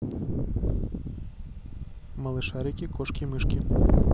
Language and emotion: Russian, neutral